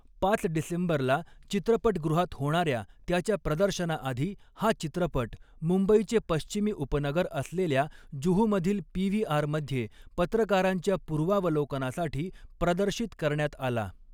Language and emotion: Marathi, neutral